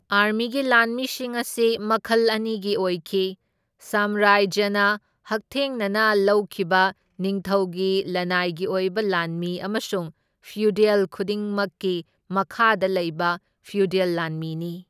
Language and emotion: Manipuri, neutral